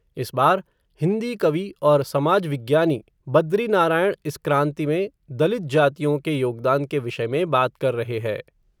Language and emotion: Hindi, neutral